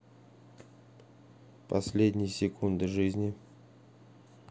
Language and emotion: Russian, neutral